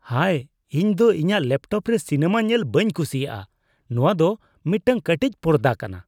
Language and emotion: Santali, disgusted